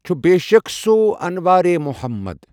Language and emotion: Kashmiri, neutral